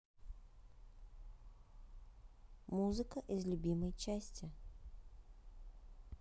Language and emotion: Russian, neutral